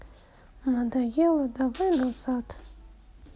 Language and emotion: Russian, sad